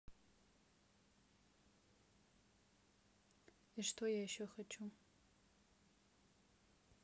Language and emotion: Russian, sad